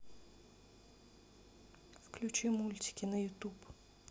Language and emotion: Russian, neutral